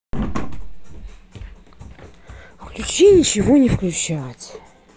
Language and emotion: Russian, angry